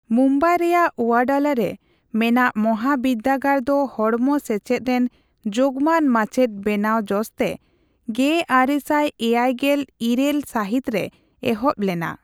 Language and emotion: Santali, neutral